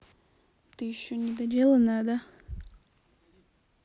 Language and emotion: Russian, neutral